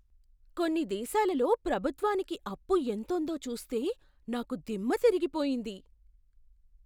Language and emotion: Telugu, surprised